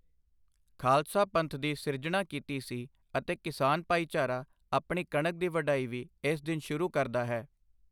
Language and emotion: Punjabi, neutral